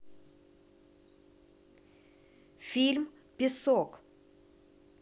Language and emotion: Russian, neutral